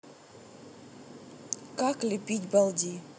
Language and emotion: Russian, neutral